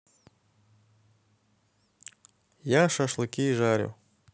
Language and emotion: Russian, neutral